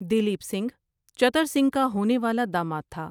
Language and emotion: Urdu, neutral